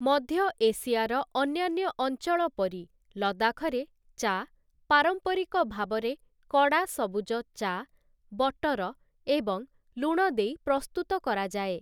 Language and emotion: Odia, neutral